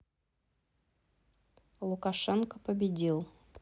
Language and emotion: Russian, neutral